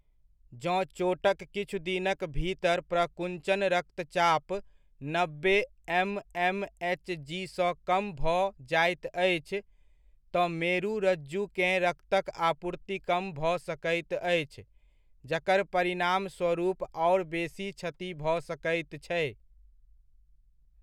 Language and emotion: Maithili, neutral